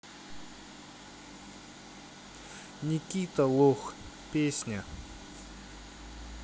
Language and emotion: Russian, neutral